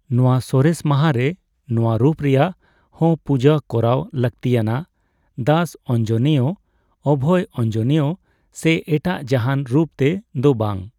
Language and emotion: Santali, neutral